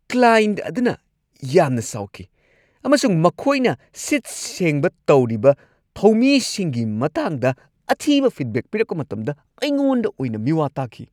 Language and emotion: Manipuri, angry